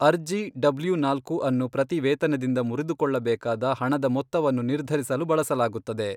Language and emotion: Kannada, neutral